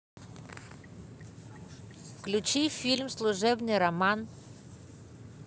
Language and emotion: Russian, positive